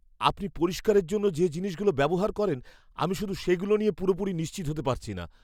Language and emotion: Bengali, fearful